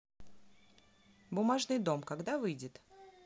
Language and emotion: Russian, neutral